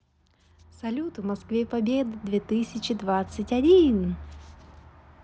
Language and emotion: Russian, positive